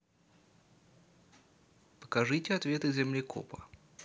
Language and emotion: Russian, neutral